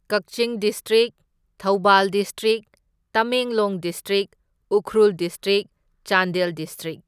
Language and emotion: Manipuri, neutral